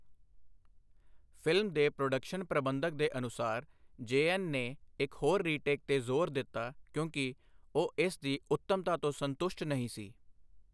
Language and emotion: Punjabi, neutral